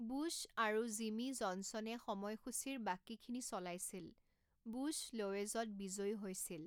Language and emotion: Assamese, neutral